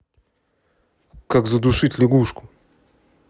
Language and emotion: Russian, neutral